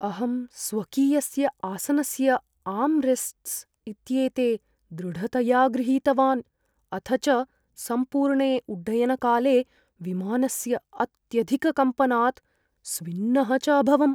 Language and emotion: Sanskrit, fearful